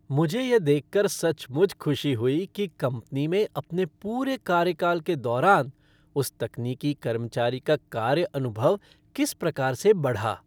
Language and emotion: Hindi, happy